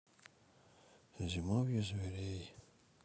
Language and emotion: Russian, sad